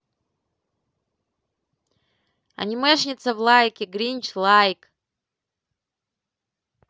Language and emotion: Russian, positive